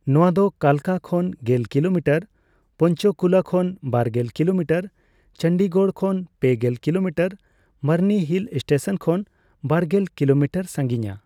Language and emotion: Santali, neutral